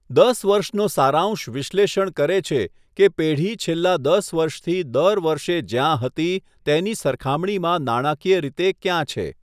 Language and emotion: Gujarati, neutral